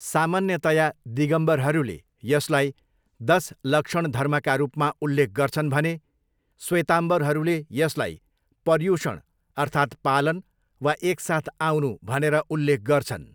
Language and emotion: Nepali, neutral